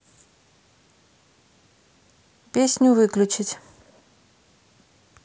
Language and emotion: Russian, neutral